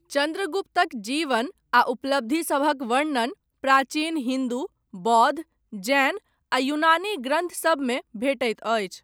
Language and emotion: Maithili, neutral